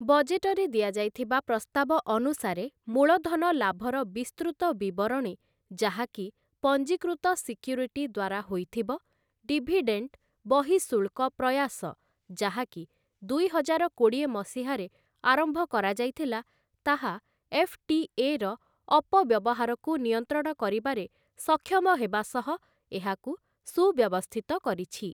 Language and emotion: Odia, neutral